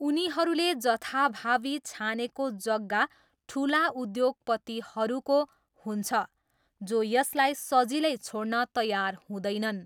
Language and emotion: Nepali, neutral